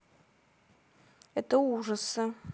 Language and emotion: Russian, neutral